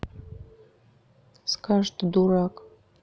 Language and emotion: Russian, neutral